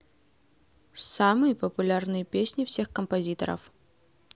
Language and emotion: Russian, neutral